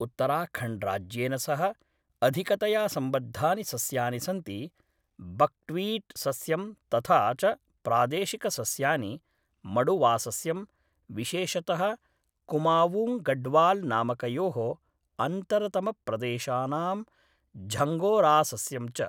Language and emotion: Sanskrit, neutral